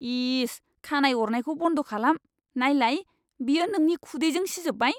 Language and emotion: Bodo, disgusted